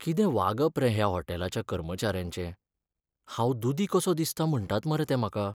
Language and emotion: Goan Konkani, sad